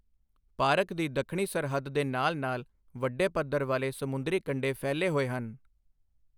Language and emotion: Punjabi, neutral